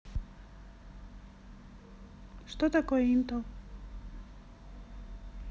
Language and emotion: Russian, neutral